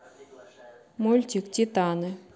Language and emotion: Russian, neutral